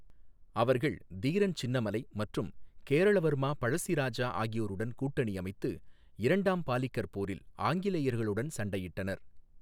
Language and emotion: Tamil, neutral